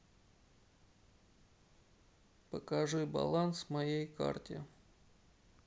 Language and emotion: Russian, sad